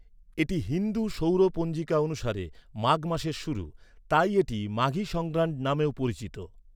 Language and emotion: Bengali, neutral